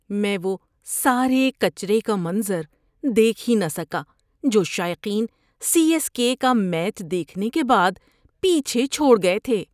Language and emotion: Urdu, disgusted